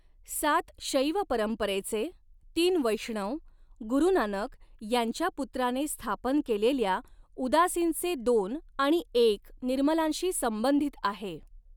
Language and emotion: Marathi, neutral